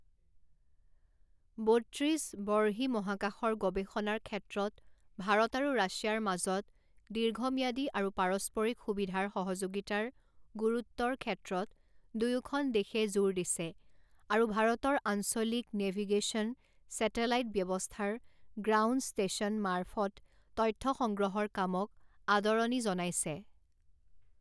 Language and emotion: Assamese, neutral